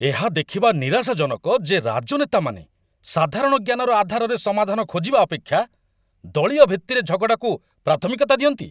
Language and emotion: Odia, angry